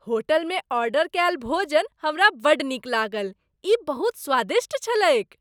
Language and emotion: Maithili, happy